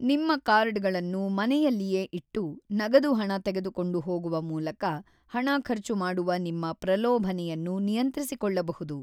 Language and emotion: Kannada, neutral